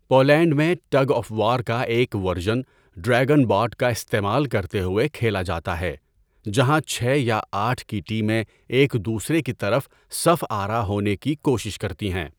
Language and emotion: Urdu, neutral